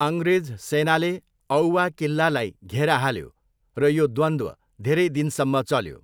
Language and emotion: Nepali, neutral